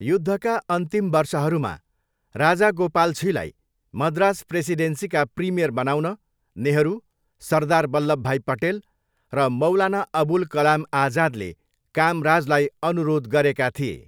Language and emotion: Nepali, neutral